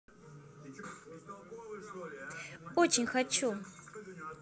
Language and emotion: Russian, positive